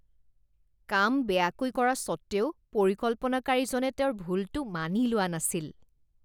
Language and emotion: Assamese, disgusted